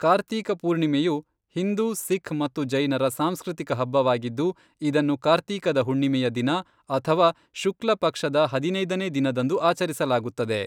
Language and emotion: Kannada, neutral